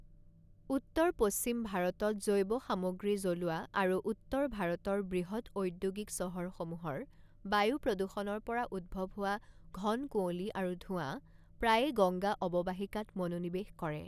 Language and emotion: Assamese, neutral